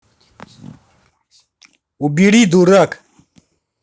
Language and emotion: Russian, angry